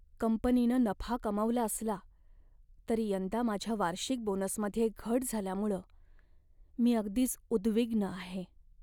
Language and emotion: Marathi, sad